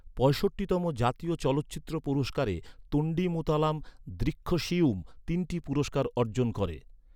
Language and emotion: Bengali, neutral